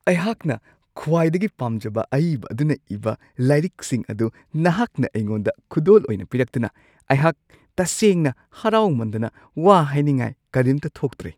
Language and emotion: Manipuri, surprised